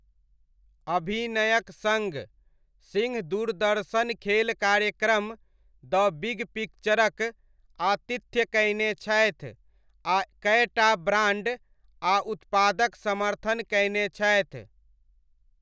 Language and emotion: Maithili, neutral